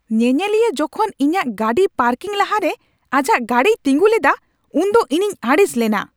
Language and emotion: Santali, angry